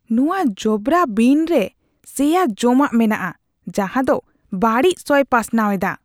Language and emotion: Santali, disgusted